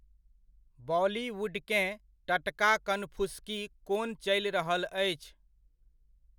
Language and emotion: Maithili, neutral